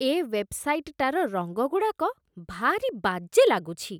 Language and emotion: Odia, disgusted